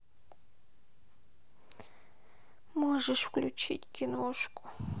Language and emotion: Russian, sad